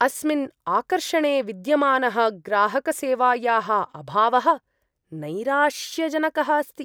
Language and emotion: Sanskrit, disgusted